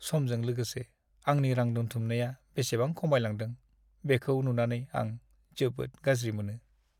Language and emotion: Bodo, sad